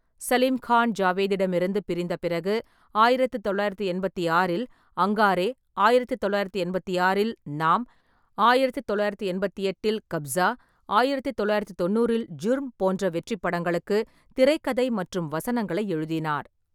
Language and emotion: Tamil, neutral